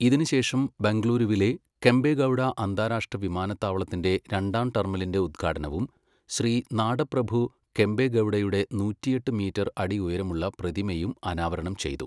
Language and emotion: Malayalam, neutral